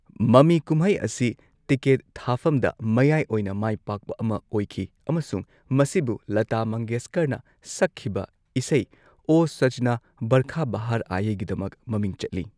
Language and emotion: Manipuri, neutral